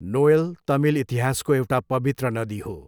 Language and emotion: Nepali, neutral